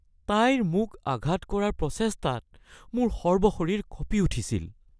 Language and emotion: Assamese, fearful